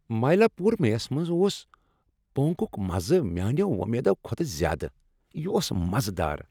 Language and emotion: Kashmiri, happy